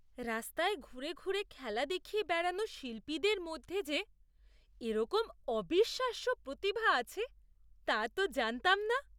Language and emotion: Bengali, surprised